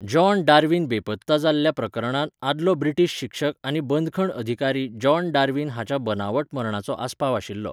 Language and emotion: Goan Konkani, neutral